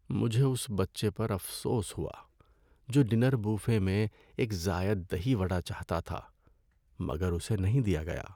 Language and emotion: Urdu, sad